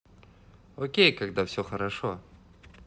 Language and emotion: Russian, positive